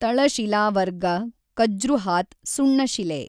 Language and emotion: Kannada, neutral